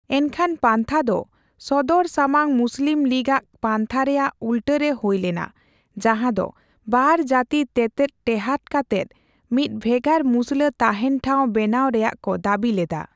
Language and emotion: Santali, neutral